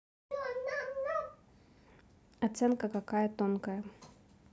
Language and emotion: Russian, neutral